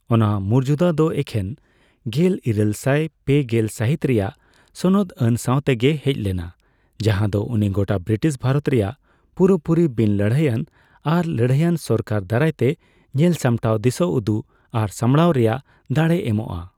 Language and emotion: Santali, neutral